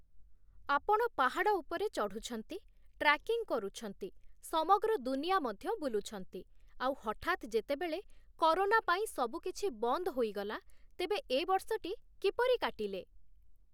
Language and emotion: Odia, neutral